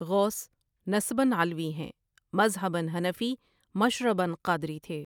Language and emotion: Urdu, neutral